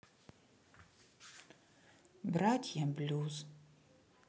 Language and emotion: Russian, sad